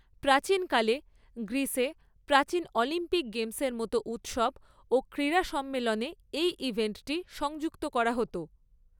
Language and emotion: Bengali, neutral